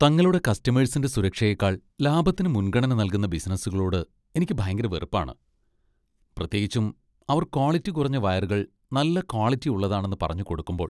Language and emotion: Malayalam, disgusted